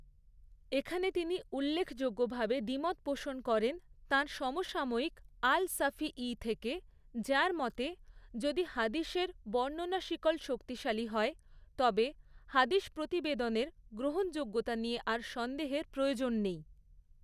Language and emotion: Bengali, neutral